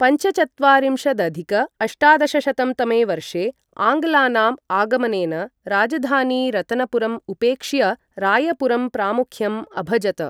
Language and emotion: Sanskrit, neutral